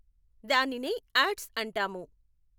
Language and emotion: Telugu, neutral